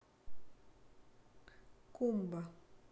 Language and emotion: Russian, neutral